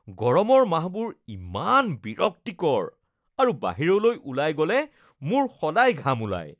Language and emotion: Assamese, disgusted